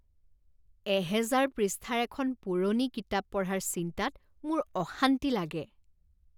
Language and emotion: Assamese, disgusted